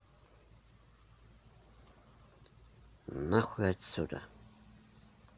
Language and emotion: Russian, neutral